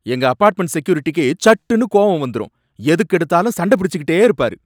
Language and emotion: Tamil, angry